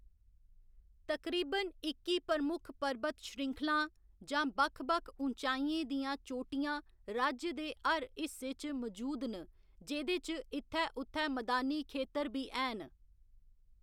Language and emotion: Dogri, neutral